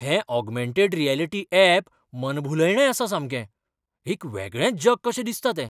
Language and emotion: Goan Konkani, surprised